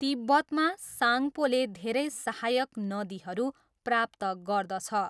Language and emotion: Nepali, neutral